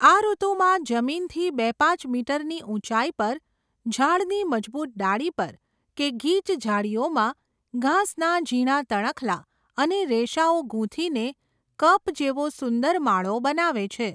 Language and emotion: Gujarati, neutral